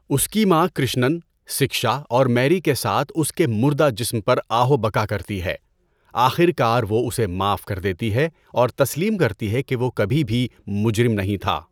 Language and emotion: Urdu, neutral